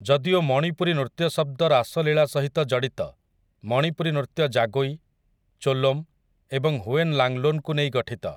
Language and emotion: Odia, neutral